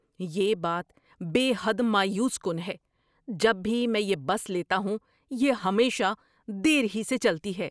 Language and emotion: Urdu, angry